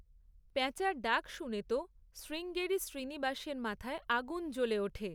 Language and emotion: Bengali, neutral